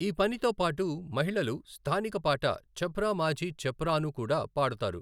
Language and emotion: Telugu, neutral